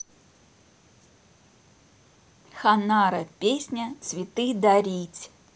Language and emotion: Russian, neutral